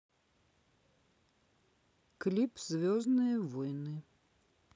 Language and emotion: Russian, neutral